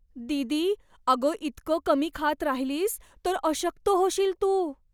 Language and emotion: Marathi, fearful